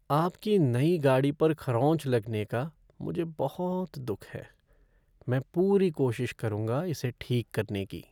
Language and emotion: Hindi, sad